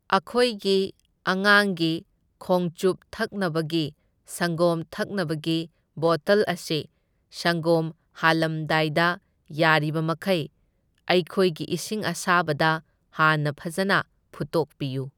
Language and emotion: Manipuri, neutral